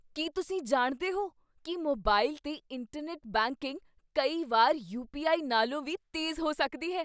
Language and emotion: Punjabi, surprised